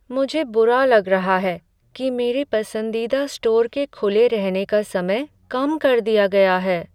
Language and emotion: Hindi, sad